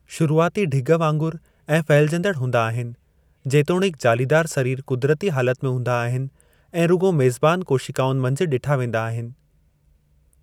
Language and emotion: Sindhi, neutral